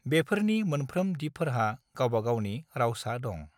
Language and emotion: Bodo, neutral